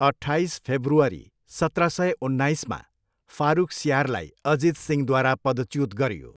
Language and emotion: Nepali, neutral